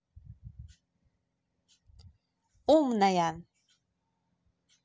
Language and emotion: Russian, positive